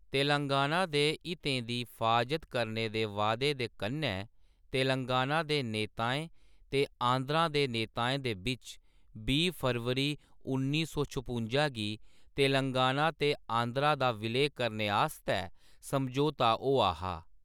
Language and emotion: Dogri, neutral